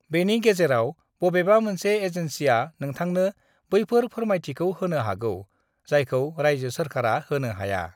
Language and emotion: Bodo, neutral